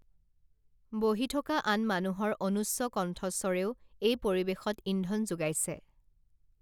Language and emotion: Assamese, neutral